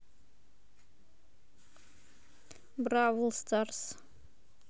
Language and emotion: Russian, neutral